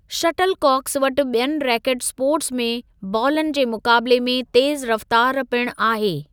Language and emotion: Sindhi, neutral